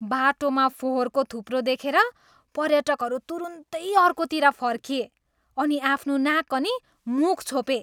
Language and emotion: Nepali, disgusted